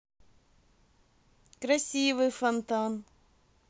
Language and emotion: Russian, positive